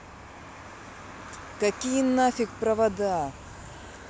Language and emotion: Russian, angry